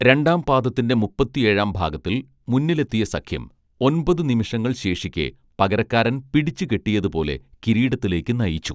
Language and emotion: Malayalam, neutral